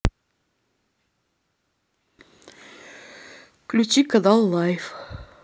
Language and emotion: Russian, neutral